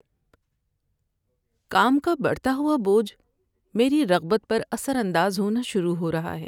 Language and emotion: Urdu, sad